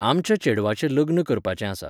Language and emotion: Goan Konkani, neutral